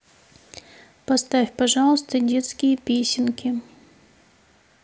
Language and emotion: Russian, neutral